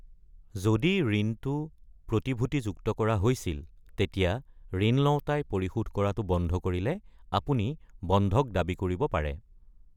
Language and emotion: Assamese, neutral